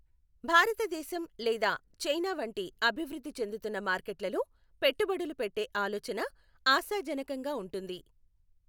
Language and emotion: Telugu, neutral